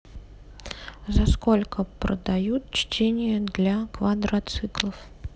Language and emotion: Russian, neutral